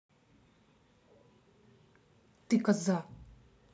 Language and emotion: Russian, angry